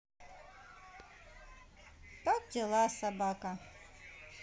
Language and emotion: Russian, positive